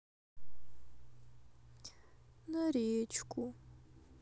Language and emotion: Russian, sad